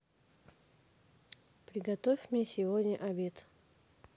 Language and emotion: Russian, neutral